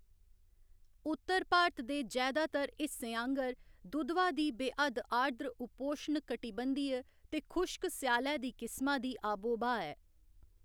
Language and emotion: Dogri, neutral